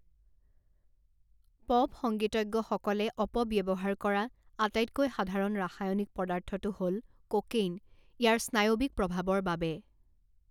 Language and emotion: Assamese, neutral